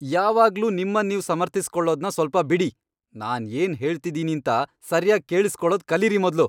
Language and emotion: Kannada, angry